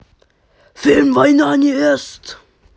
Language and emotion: Russian, angry